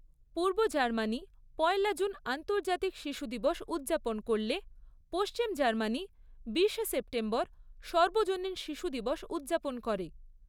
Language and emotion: Bengali, neutral